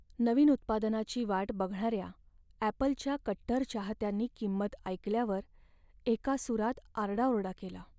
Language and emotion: Marathi, sad